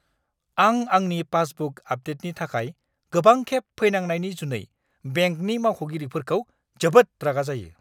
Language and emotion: Bodo, angry